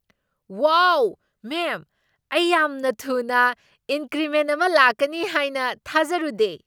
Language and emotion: Manipuri, surprised